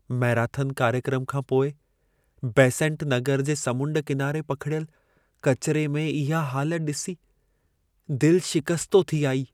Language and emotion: Sindhi, sad